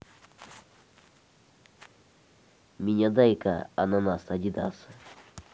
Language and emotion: Russian, neutral